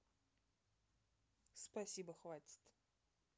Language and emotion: Russian, neutral